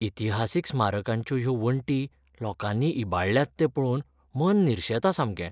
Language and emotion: Goan Konkani, sad